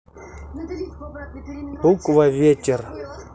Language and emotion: Russian, neutral